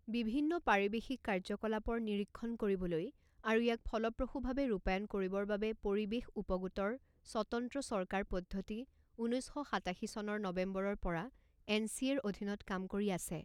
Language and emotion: Assamese, neutral